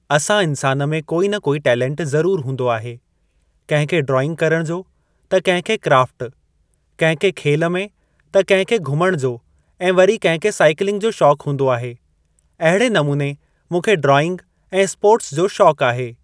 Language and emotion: Sindhi, neutral